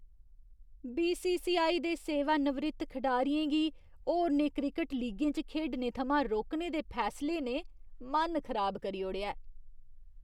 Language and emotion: Dogri, disgusted